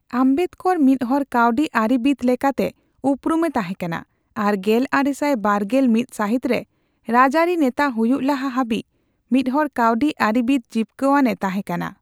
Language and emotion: Santali, neutral